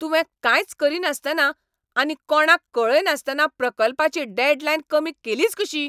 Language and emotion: Goan Konkani, angry